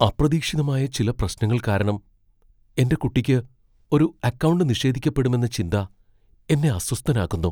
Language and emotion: Malayalam, fearful